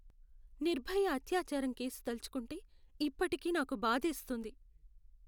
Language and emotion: Telugu, sad